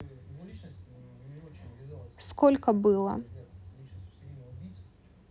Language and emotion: Russian, neutral